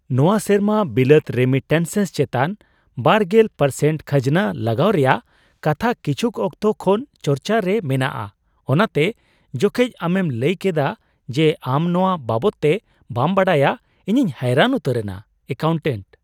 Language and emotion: Santali, surprised